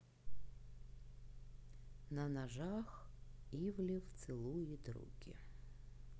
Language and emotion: Russian, neutral